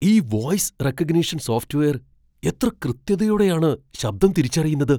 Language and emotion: Malayalam, surprised